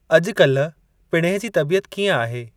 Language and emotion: Sindhi, neutral